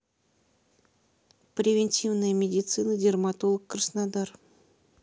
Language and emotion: Russian, neutral